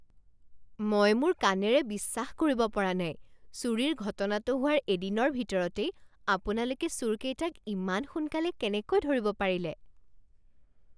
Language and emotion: Assamese, surprised